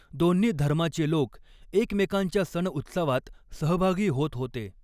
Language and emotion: Marathi, neutral